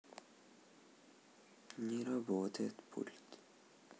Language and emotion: Russian, sad